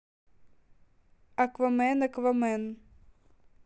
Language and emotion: Russian, neutral